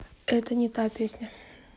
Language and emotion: Russian, neutral